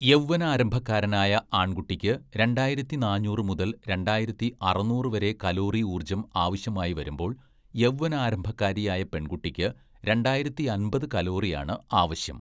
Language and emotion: Malayalam, neutral